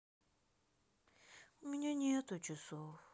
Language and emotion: Russian, sad